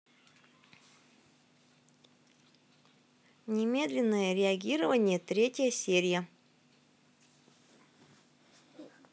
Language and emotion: Russian, neutral